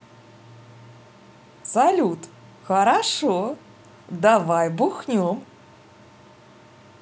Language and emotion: Russian, positive